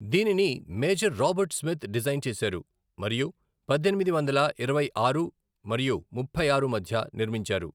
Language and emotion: Telugu, neutral